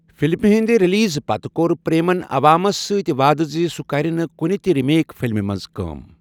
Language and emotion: Kashmiri, neutral